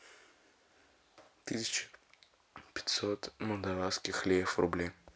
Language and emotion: Russian, neutral